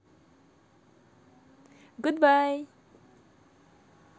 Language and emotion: Russian, positive